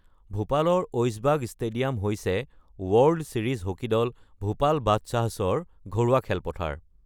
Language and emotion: Assamese, neutral